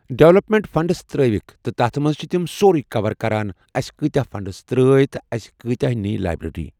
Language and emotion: Kashmiri, neutral